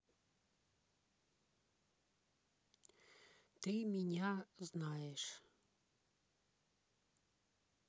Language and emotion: Russian, neutral